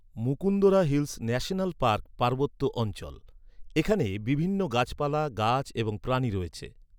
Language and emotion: Bengali, neutral